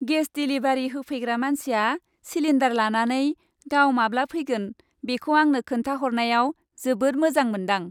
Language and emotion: Bodo, happy